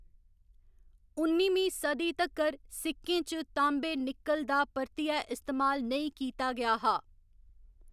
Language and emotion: Dogri, neutral